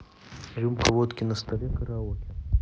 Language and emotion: Russian, neutral